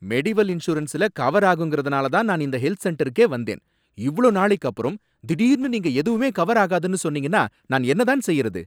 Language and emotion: Tamil, angry